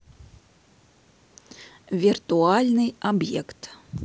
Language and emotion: Russian, neutral